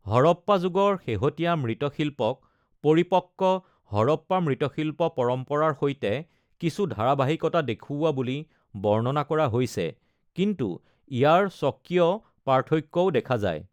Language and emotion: Assamese, neutral